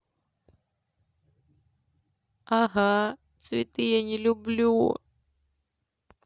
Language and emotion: Russian, sad